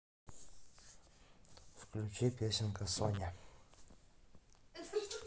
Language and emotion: Russian, neutral